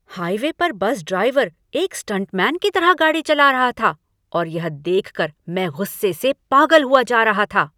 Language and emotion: Hindi, angry